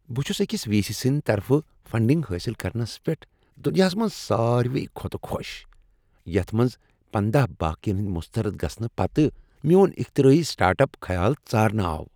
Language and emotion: Kashmiri, happy